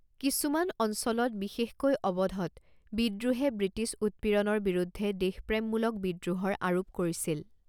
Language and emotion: Assamese, neutral